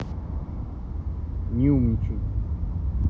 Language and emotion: Russian, neutral